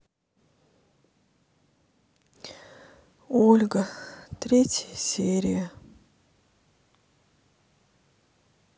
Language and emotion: Russian, sad